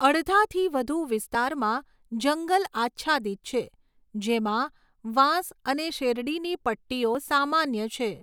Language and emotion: Gujarati, neutral